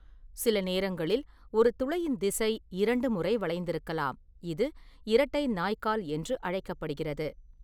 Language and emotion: Tamil, neutral